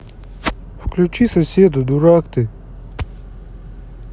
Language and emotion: Russian, neutral